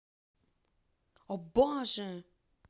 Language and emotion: Russian, angry